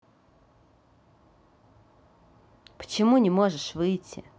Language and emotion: Russian, neutral